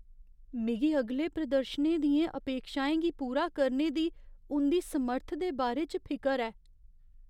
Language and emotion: Dogri, fearful